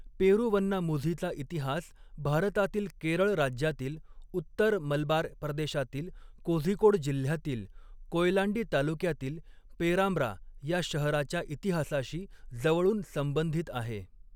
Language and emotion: Marathi, neutral